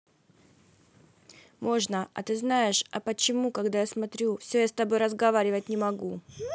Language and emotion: Russian, neutral